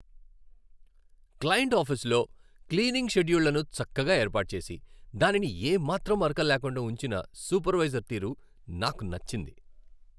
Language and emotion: Telugu, happy